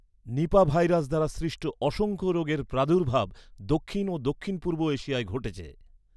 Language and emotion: Bengali, neutral